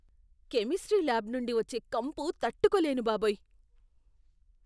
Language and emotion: Telugu, disgusted